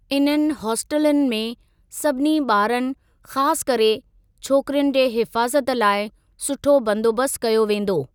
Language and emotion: Sindhi, neutral